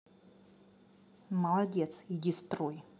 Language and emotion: Russian, angry